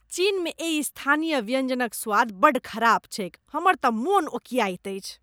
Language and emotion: Maithili, disgusted